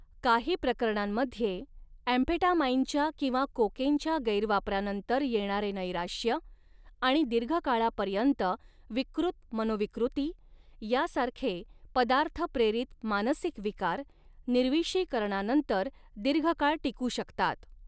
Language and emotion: Marathi, neutral